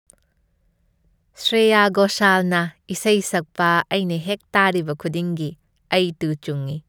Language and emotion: Manipuri, happy